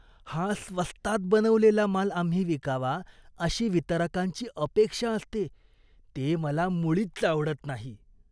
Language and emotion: Marathi, disgusted